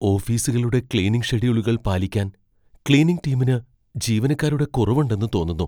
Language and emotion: Malayalam, fearful